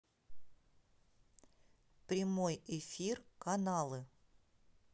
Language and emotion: Russian, neutral